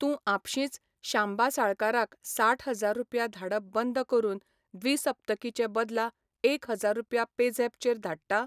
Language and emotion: Goan Konkani, neutral